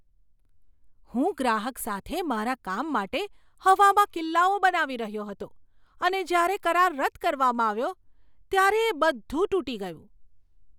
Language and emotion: Gujarati, surprised